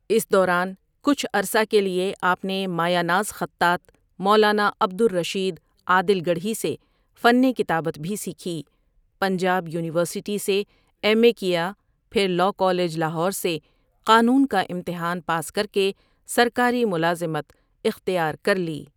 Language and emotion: Urdu, neutral